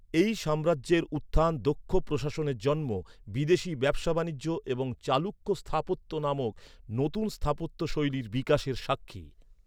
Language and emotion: Bengali, neutral